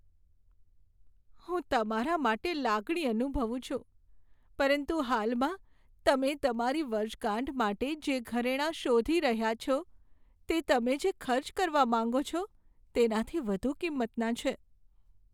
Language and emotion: Gujarati, sad